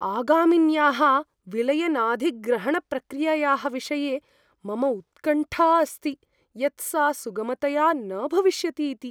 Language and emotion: Sanskrit, fearful